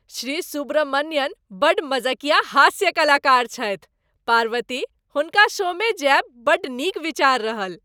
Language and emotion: Maithili, happy